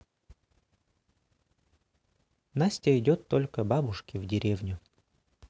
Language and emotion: Russian, neutral